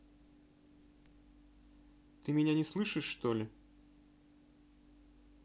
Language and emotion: Russian, neutral